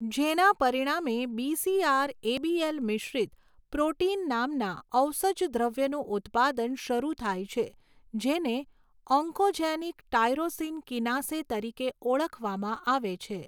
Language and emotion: Gujarati, neutral